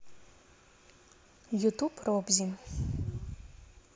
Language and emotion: Russian, neutral